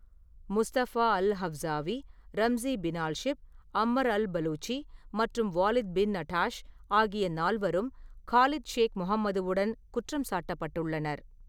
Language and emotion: Tamil, neutral